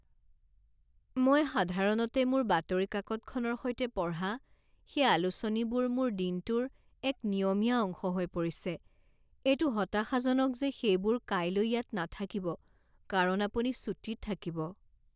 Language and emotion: Assamese, sad